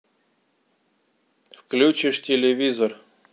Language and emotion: Russian, neutral